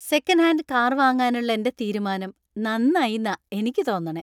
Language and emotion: Malayalam, happy